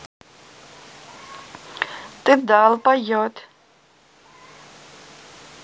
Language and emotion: Russian, neutral